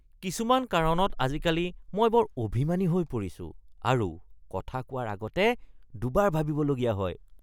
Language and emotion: Assamese, disgusted